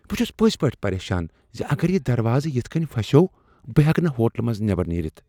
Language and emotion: Kashmiri, fearful